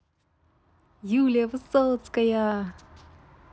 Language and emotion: Russian, positive